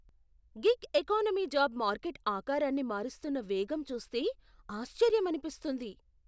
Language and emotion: Telugu, surprised